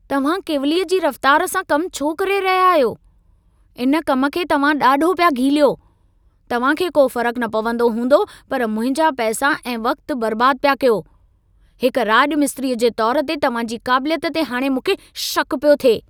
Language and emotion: Sindhi, angry